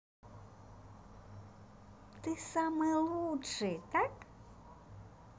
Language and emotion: Russian, positive